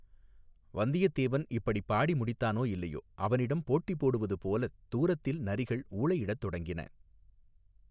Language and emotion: Tamil, neutral